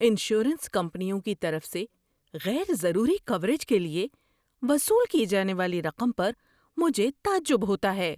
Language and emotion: Urdu, surprised